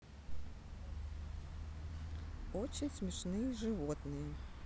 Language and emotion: Russian, neutral